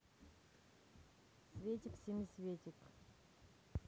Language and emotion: Russian, neutral